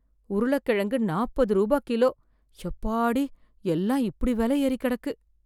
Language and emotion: Tamil, fearful